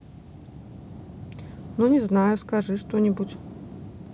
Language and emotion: Russian, neutral